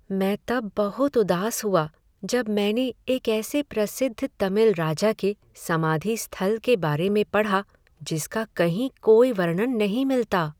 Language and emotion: Hindi, sad